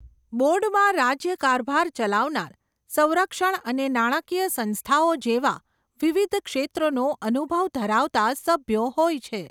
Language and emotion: Gujarati, neutral